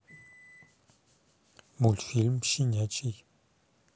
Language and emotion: Russian, neutral